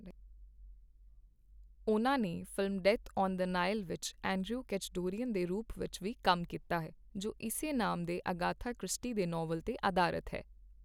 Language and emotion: Punjabi, neutral